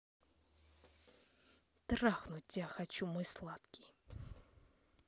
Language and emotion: Russian, angry